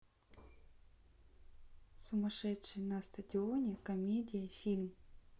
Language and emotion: Russian, neutral